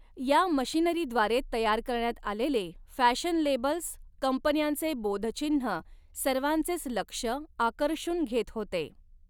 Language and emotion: Marathi, neutral